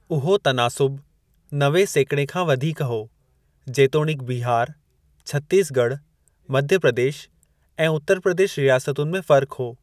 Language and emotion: Sindhi, neutral